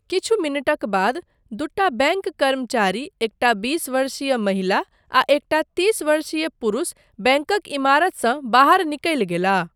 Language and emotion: Maithili, neutral